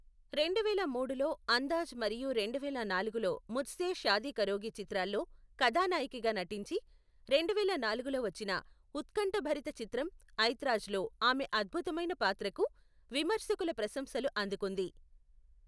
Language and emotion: Telugu, neutral